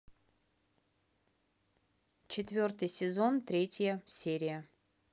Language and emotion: Russian, neutral